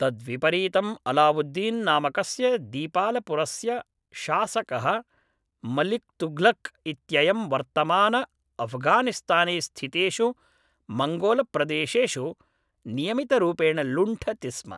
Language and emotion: Sanskrit, neutral